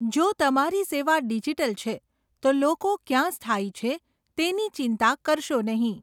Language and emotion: Gujarati, neutral